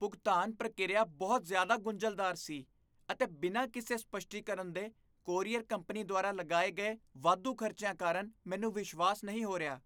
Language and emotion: Punjabi, disgusted